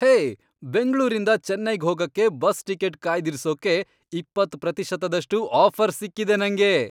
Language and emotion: Kannada, happy